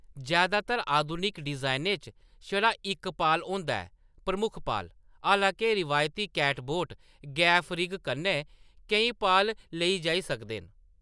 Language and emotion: Dogri, neutral